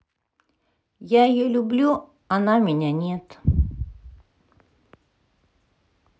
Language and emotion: Russian, sad